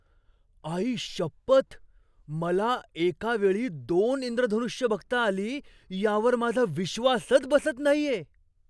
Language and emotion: Marathi, surprised